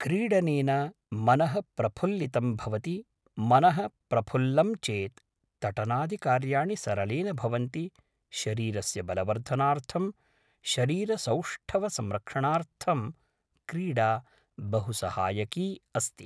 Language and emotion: Sanskrit, neutral